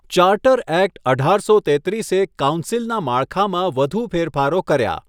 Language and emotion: Gujarati, neutral